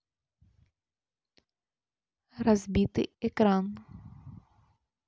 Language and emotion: Russian, neutral